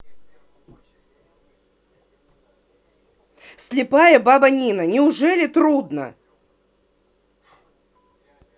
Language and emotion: Russian, angry